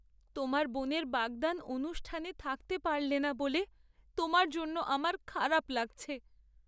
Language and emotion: Bengali, sad